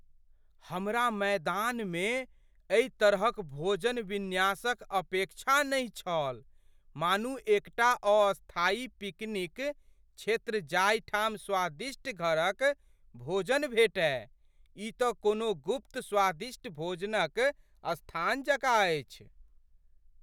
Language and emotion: Maithili, surprised